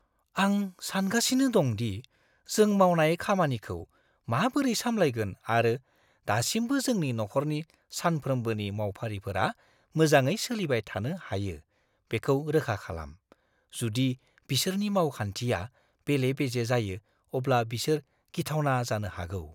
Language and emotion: Bodo, fearful